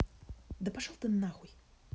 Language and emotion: Russian, angry